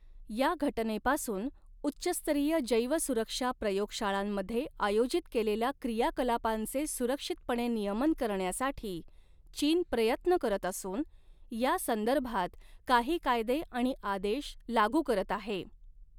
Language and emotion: Marathi, neutral